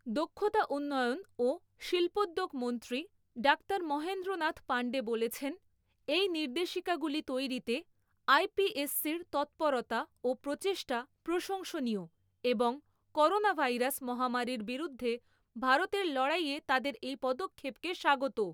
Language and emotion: Bengali, neutral